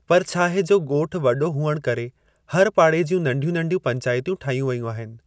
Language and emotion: Sindhi, neutral